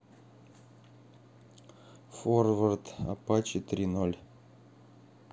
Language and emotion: Russian, neutral